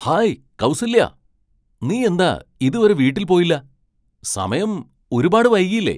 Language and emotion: Malayalam, surprised